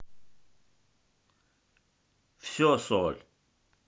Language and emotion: Russian, neutral